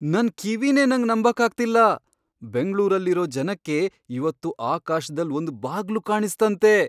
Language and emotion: Kannada, surprised